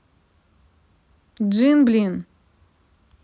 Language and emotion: Russian, angry